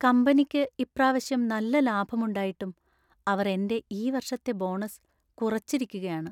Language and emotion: Malayalam, sad